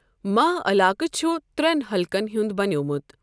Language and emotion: Kashmiri, neutral